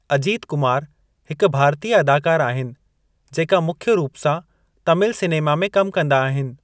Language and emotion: Sindhi, neutral